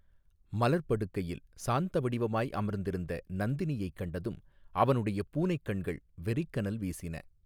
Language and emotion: Tamil, neutral